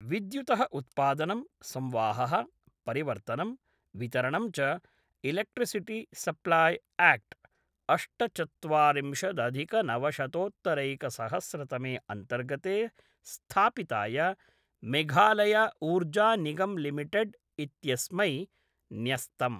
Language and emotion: Sanskrit, neutral